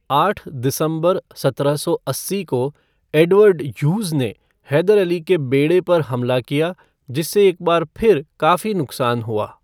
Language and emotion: Hindi, neutral